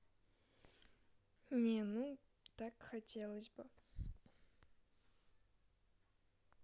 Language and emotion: Russian, sad